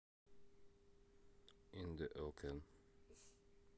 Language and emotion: Russian, neutral